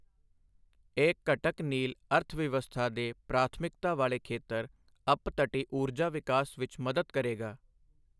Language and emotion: Punjabi, neutral